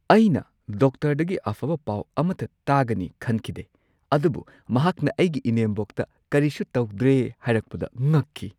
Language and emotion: Manipuri, surprised